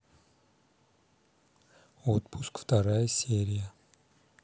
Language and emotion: Russian, neutral